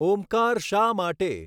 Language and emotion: Gujarati, neutral